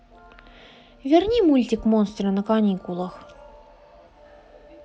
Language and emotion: Russian, neutral